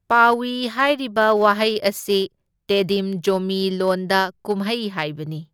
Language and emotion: Manipuri, neutral